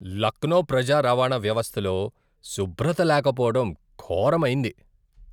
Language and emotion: Telugu, disgusted